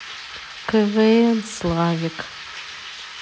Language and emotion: Russian, sad